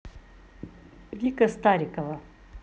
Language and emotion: Russian, positive